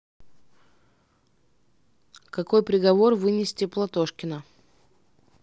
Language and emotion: Russian, neutral